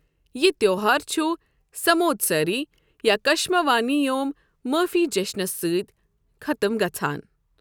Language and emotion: Kashmiri, neutral